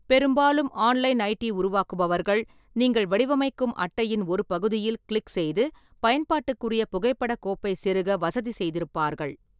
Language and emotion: Tamil, neutral